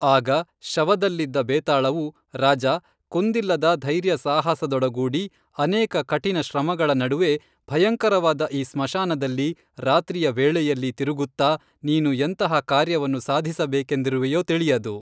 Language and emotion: Kannada, neutral